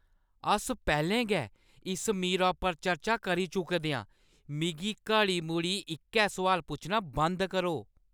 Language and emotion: Dogri, angry